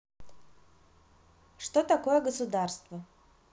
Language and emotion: Russian, neutral